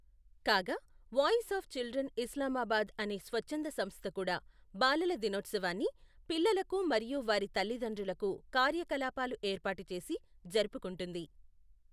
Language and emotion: Telugu, neutral